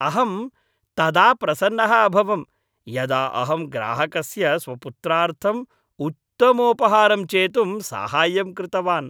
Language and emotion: Sanskrit, happy